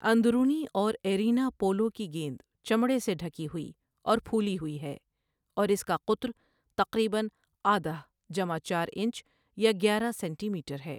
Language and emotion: Urdu, neutral